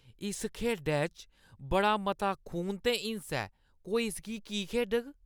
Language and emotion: Dogri, disgusted